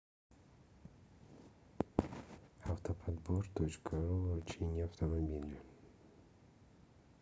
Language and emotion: Russian, sad